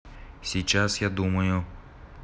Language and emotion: Russian, neutral